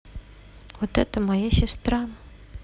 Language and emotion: Russian, neutral